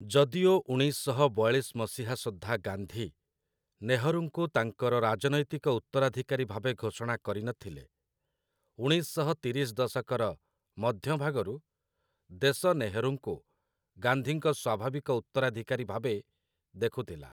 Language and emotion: Odia, neutral